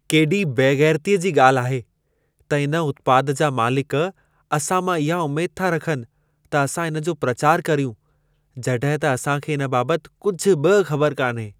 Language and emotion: Sindhi, disgusted